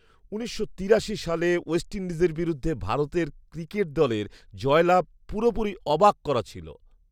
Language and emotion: Bengali, surprised